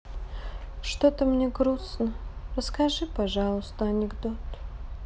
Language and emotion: Russian, sad